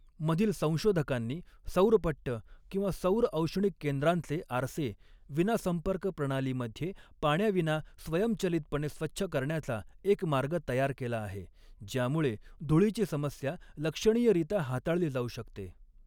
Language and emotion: Marathi, neutral